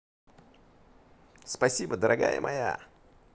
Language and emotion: Russian, positive